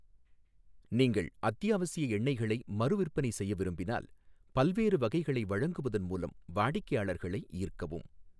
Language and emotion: Tamil, neutral